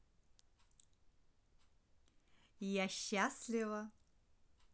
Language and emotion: Russian, positive